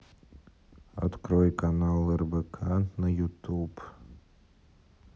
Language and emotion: Russian, neutral